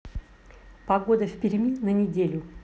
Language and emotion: Russian, neutral